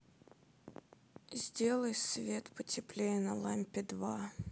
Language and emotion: Russian, sad